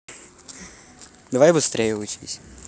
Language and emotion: Russian, neutral